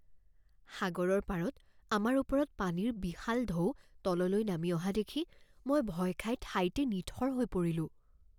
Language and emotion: Assamese, fearful